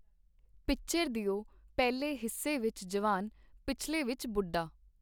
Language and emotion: Punjabi, neutral